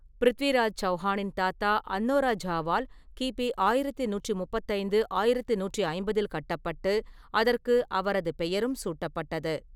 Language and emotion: Tamil, neutral